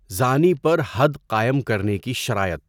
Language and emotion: Urdu, neutral